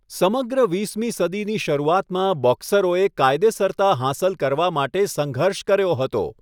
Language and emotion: Gujarati, neutral